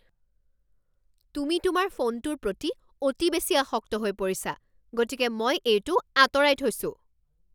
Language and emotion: Assamese, angry